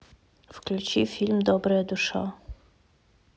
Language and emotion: Russian, neutral